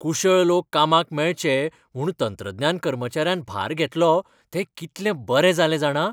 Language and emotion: Goan Konkani, happy